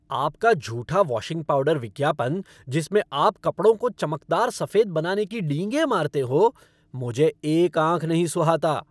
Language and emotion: Hindi, angry